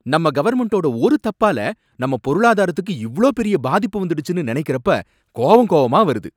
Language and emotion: Tamil, angry